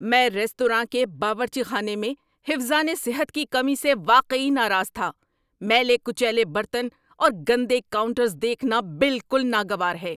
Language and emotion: Urdu, angry